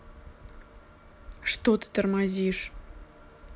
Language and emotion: Russian, neutral